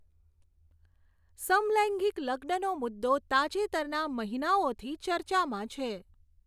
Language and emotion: Gujarati, neutral